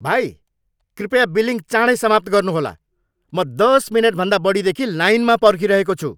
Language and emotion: Nepali, angry